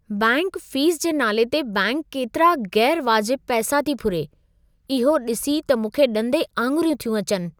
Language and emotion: Sindhi, surprised